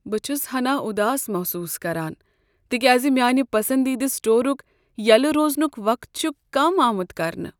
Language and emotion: Kashmiri, sad